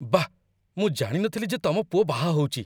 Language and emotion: Odia, surprised